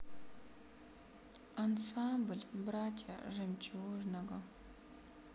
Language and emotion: Russian, sad